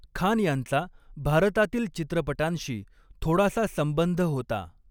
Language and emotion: Marathi, neutral